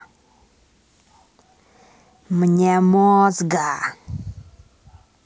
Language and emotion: Russian, angry